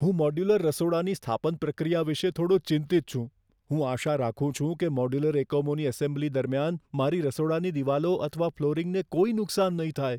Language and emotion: Gujarati, fearful